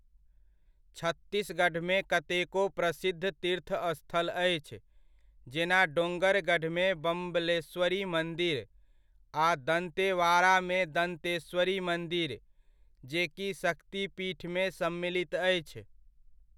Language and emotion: Maithili, neutral